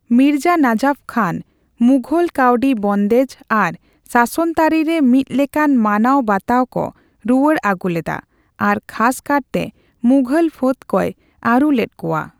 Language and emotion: Santali, neutral